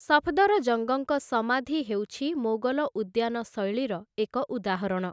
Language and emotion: Odia, neutral